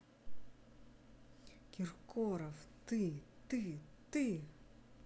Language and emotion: Russian, angry